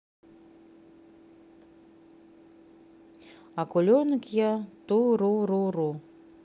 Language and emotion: Russian, neutral